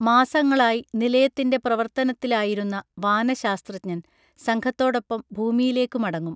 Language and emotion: Malayalam, neutral